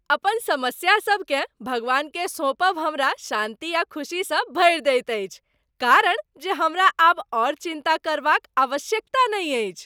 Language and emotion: Maithili, happy